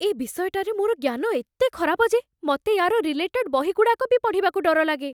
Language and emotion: Odia, fearful